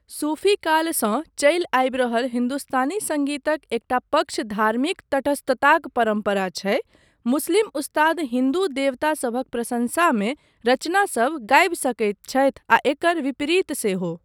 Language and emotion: Maithili, neutral